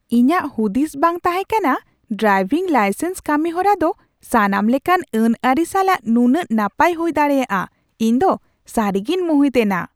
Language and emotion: Santali, surprised